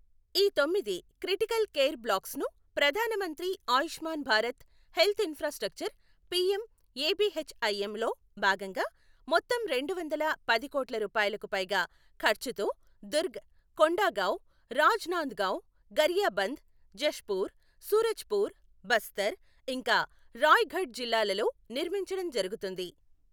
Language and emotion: Telugu, neutral